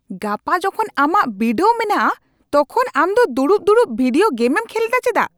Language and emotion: Santali, angry